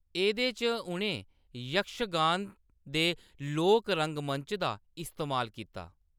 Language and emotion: Dogri, neutral